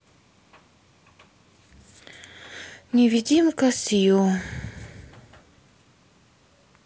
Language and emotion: Russian, sad